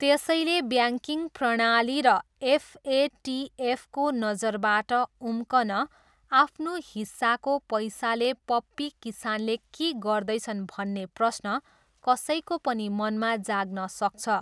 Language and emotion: Nepali, neutral